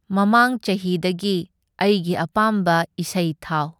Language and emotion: Manipuri, neutral